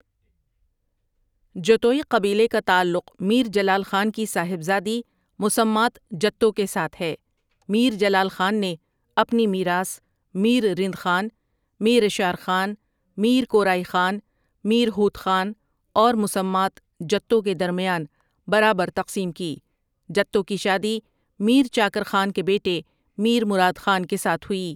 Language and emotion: Urdu, neutral